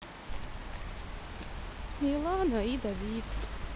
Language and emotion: Russian, sad